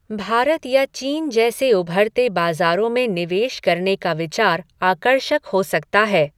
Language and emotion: Hindi, neutral